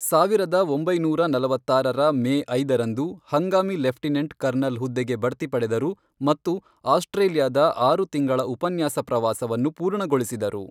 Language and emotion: Kannada, neutral